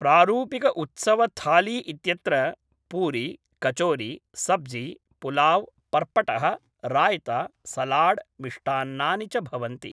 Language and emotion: Sanskrit, neutral